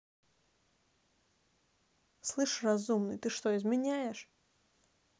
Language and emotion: Russian, angry